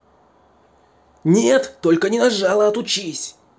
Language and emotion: Russian, angry